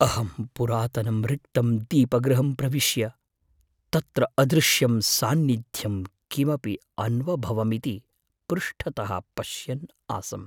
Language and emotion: Sanskrit, fearful